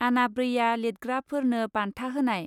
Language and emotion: Bodo, neutral